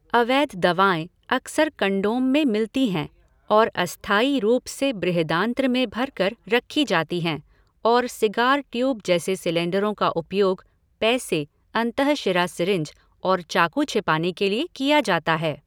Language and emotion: Hindi, neutral